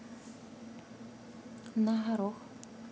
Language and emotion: Russian, neutral